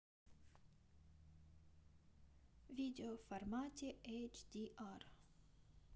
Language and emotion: Russian, neutral